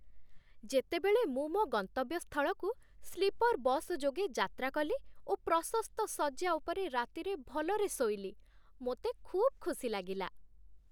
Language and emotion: Odia, happy